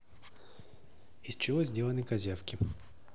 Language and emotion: Russian, neutral